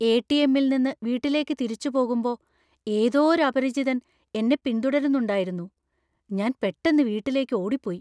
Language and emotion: Malayalam, fearful